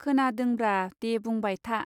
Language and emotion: Bodo, neutral